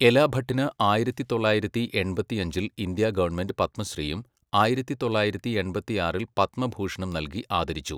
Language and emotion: Malayalam, neutral